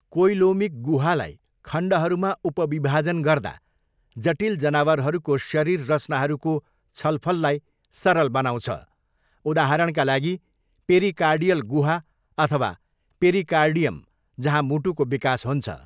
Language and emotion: Nepali, neutral